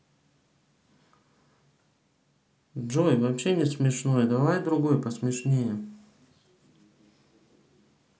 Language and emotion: Russian, neutral